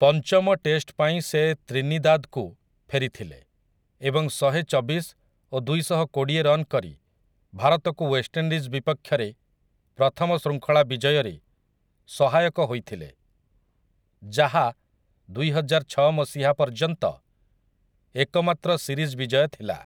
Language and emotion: Odia, neutral